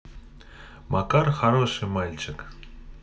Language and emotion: Russian, neutral